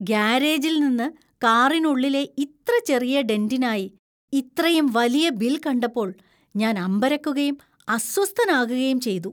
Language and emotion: Malayalam, disgusted